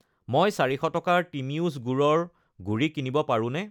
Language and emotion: Assamese, neutral